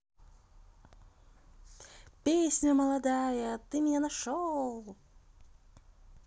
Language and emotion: Russian, positive